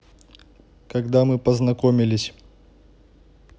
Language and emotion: Russian, neutral